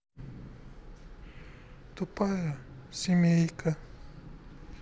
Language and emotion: Russian, sad